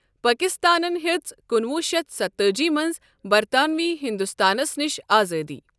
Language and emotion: Kashmiri, neutral